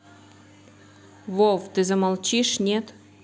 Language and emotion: Russian, angry